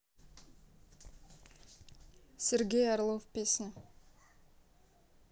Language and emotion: Russian, neutral